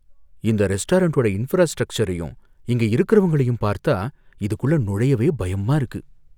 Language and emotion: Tamil, fearful